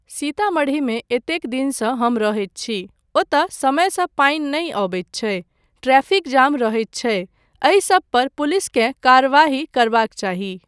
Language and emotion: Maithili, neutral